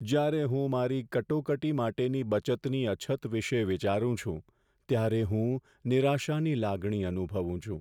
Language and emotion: Gujarati, sad